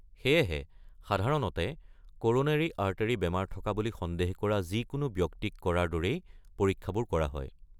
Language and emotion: Assamese, neutral